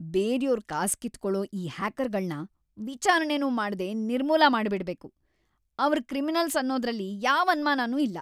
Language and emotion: Kannada, angry